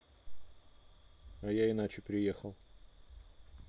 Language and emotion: Russian, neutral